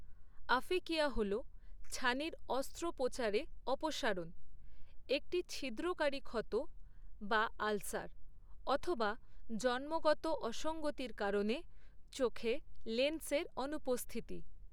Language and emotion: Bengali, neutral